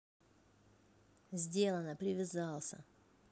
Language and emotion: Russian, neutral